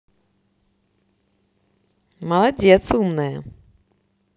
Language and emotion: Russian, positive